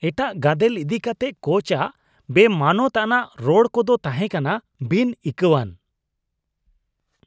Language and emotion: Santali, disgusted